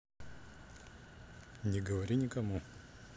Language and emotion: Russian, neutral